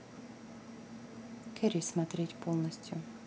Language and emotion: Russian, neutral